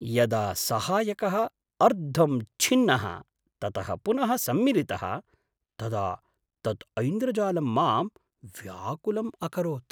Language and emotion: Sanskrit, surprised